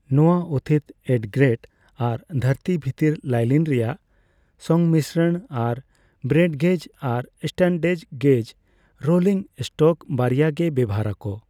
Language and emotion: Santali, neutral